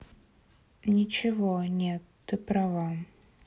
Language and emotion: Russian, sad